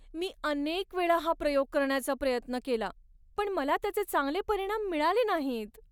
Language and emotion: Marathi, sad